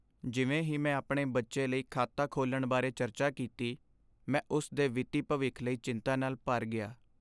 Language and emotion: Punjabi, sad